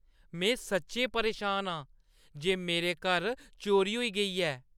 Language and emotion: Dogri, angry